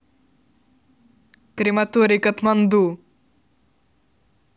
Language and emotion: Russian, neutral